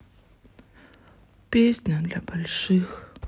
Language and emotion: Russian, sad